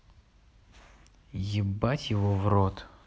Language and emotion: Russian, neutral